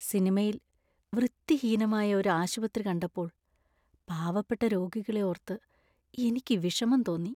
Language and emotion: Malayalam, sad